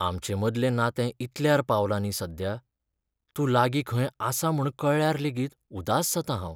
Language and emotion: Goan Konkani, sad